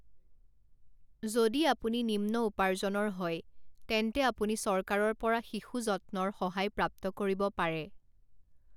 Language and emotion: Assamese, neutral